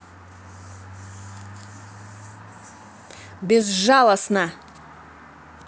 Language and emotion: Russian, angry